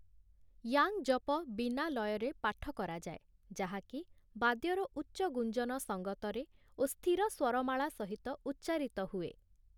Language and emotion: Odia, neutral